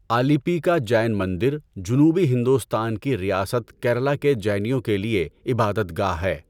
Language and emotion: Urdu, neutral